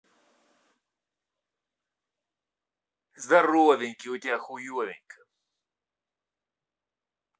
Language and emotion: Russian, angry